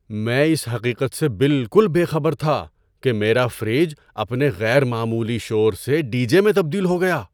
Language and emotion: Urdu, surprised